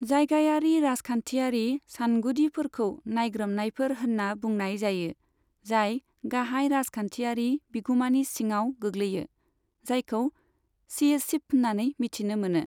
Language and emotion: Bodo, neutral